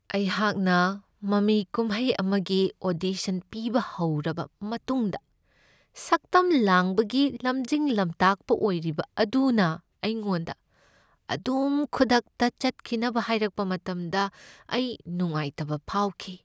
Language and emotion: Manipuri, sad